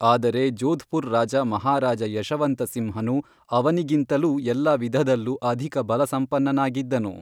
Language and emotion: Kannada, neutral